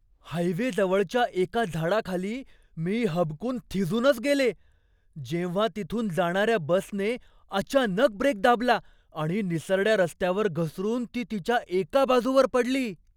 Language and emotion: Marathi, surprised